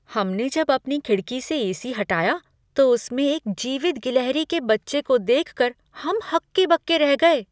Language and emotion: Hindi, surprised